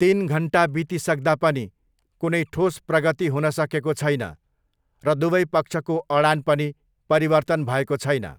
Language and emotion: Nepali, neutral